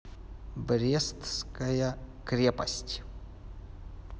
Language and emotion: Russian, neutral